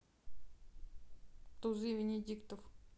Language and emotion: Russian, neutral